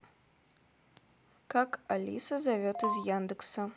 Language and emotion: Russian, neutral